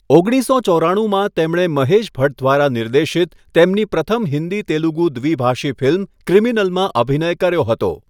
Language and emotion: Gujarati, neutral